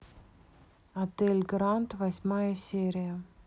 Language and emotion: Russian, neutral